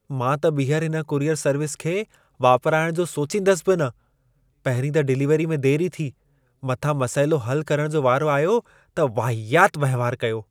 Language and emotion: Sindhi, disgusted